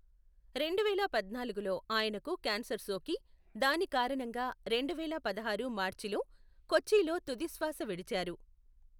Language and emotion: Telugu, neutral